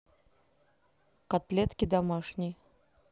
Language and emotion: Russian, neutral